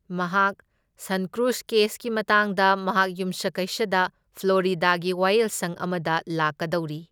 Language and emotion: Manipuri, neutral